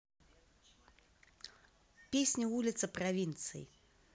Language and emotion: Russian, neutral